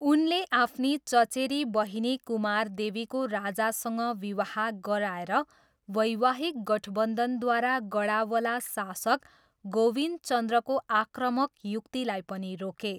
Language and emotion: Nepali, neutral